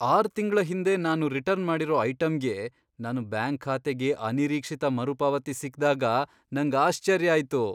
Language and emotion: Kannada, surprised